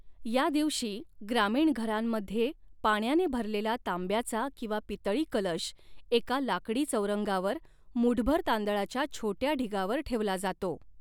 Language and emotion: Marathi, neutral